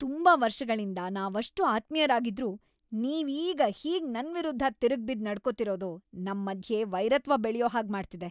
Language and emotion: Kannada, angry